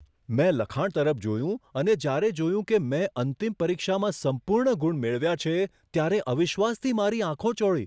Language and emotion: Gujarati, surprised